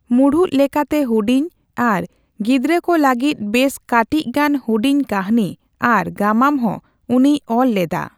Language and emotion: Santali, neutral